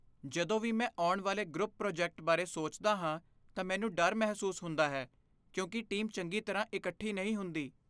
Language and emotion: Punjabi, fearful